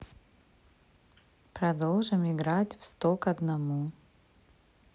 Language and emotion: Russian, neutral